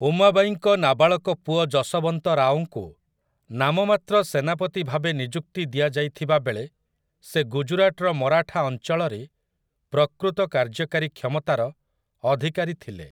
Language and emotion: Odia, neutral